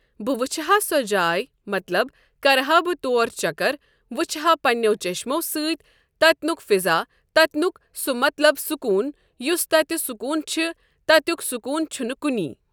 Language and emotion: Kashmiri, neutral